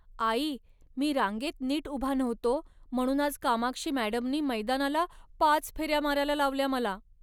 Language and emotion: Marathi, sad